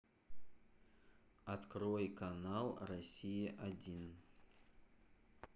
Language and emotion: Russian, neutral